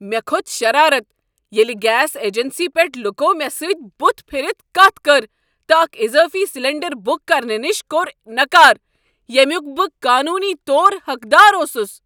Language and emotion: Kashmiri, angry